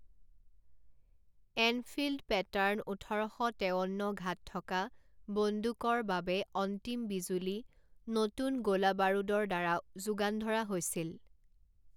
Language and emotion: Assamese, neutral